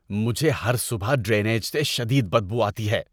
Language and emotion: Urdu, disgusted